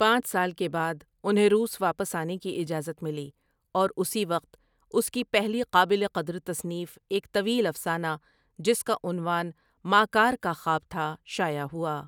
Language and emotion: Urdu, neutral